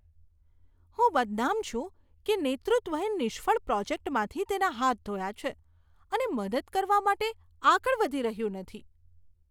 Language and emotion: Gujarati, disgusted